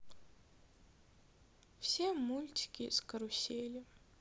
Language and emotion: Russian, sad